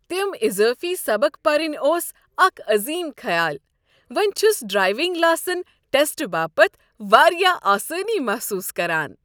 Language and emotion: Kashmiri, happy